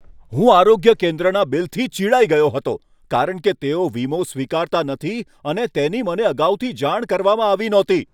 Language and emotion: Gujarati, angry